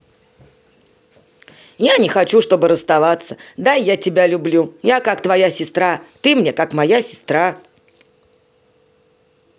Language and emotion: Russian, positive